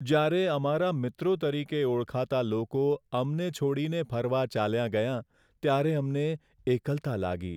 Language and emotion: Gujarati, sad